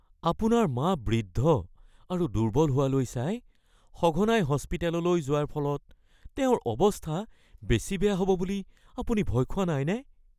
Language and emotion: Assamese, fearful